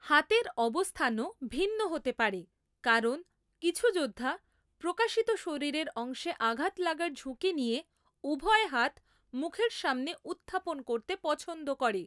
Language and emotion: Bengali, neutral